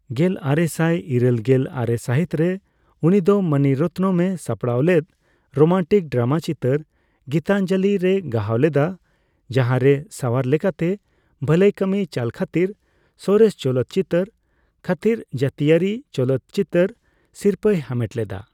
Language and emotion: Santali, neutral